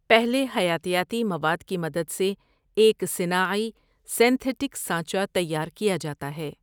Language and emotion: Urdu, neutral